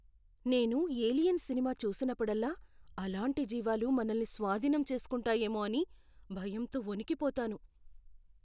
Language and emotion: Telugu, fearful